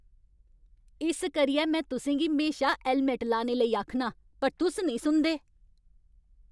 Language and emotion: Dogri, angry